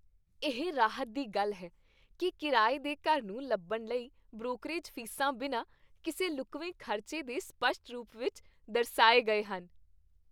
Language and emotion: Punjabi, happy